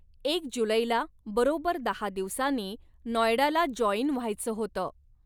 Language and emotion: Marathi, neutral